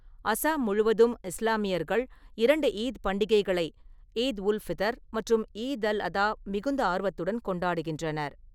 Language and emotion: Tamil, neutral